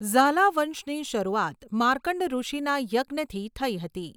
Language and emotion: Gujarati, neutral